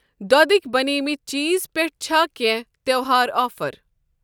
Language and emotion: Kashmiri, neutral